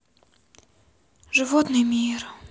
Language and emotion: Russian, sad